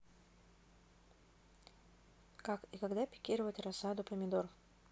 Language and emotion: Russian, neutral